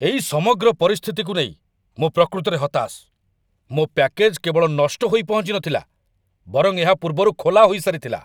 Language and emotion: Odia, angry